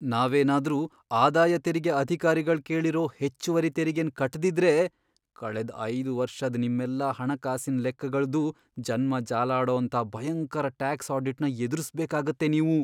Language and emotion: Kannada, fearful